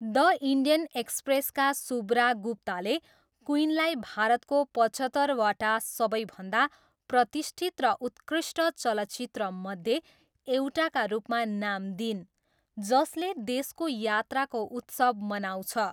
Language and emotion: Nepali, neutral